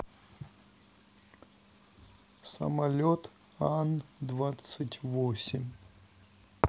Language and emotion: Russian, sad